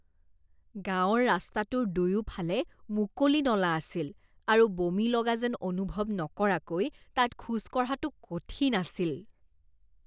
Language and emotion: Assamese, disgusted